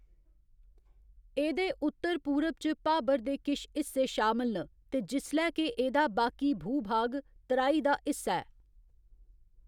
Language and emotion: Dogri, neutral